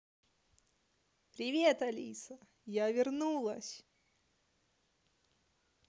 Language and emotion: Russian, positive